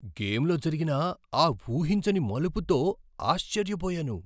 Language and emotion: Telugu, surprised